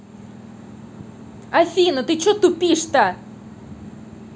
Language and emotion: Russian, angry